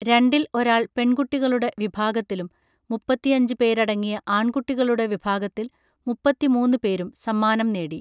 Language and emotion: Malayalam, neutral